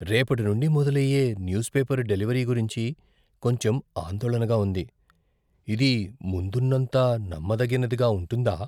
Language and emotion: Telugu, fearful